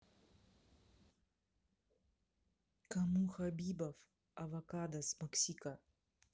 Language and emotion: Russian, neutral